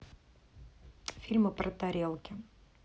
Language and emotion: Russian, neutral